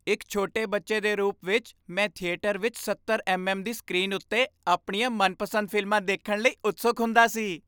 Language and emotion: Punjabi, happy